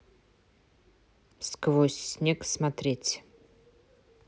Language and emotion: Russian, neutral